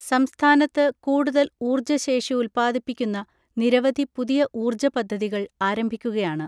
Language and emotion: Malayalam, neutral